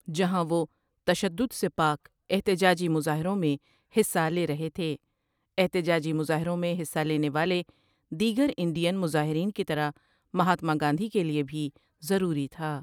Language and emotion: Urdu, neutral